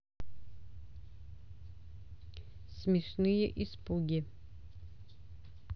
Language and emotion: Russian, neutral